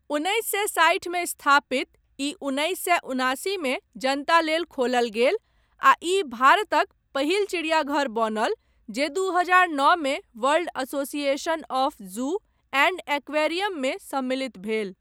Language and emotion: Maithili, neutral